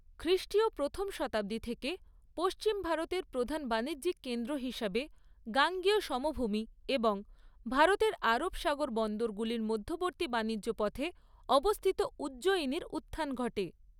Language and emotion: Bengali, neutral